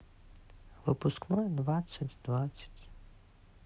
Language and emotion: Russian, sad